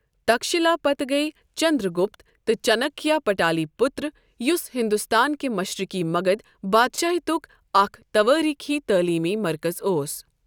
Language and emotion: Kashmiri, neutral